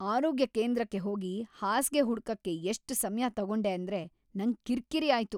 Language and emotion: Kannada, angry